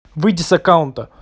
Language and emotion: Russian, angry